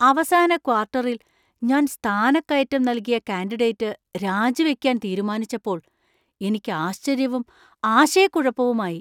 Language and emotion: Malayalam, surprised